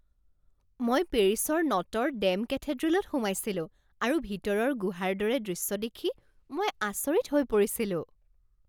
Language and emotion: Assamese, surprised